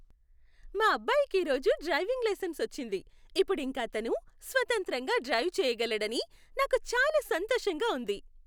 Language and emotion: Telugu, happy